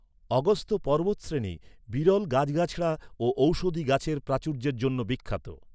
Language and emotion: Bengali, neutral